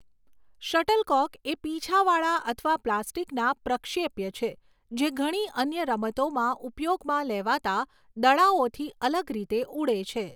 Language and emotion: Gujarati, neutral